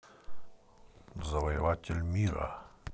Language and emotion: Russian, neutral